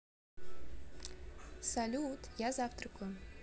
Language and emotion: Russian, neutral